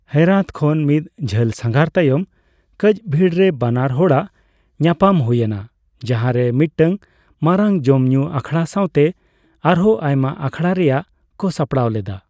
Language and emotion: Santali, neutral